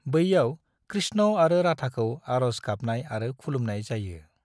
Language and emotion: Bodo, neutral